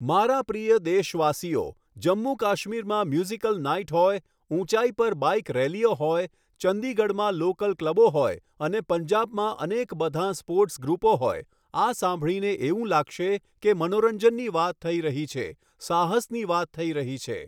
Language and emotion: Gujarati, neutral